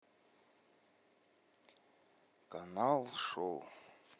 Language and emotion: Russian, sad